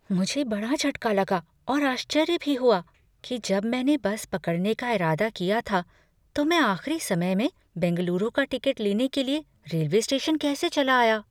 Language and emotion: Hindi, fearful